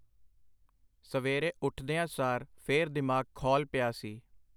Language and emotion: Punjabi, neutral